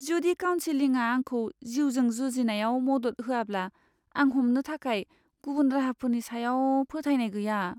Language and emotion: Bodo, fearful